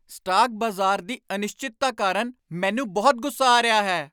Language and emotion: Punjabi, angry